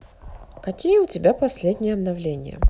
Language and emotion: Russian, neutral